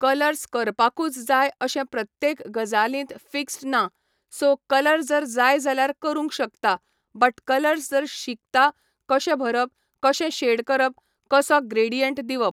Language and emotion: Goan Konkani, neutral